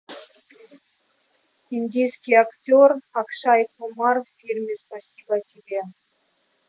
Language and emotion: Russian, neutral